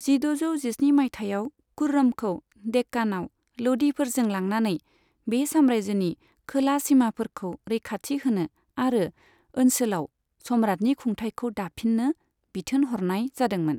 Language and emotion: Bodo, neutral